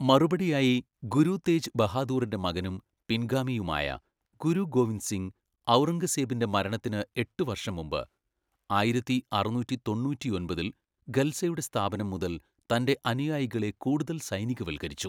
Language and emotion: Malayalam, neutral